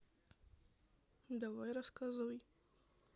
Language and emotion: Russian, neutral